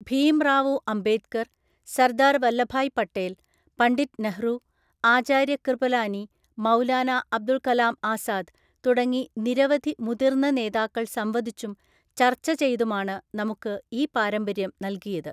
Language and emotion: Malayalam, neutral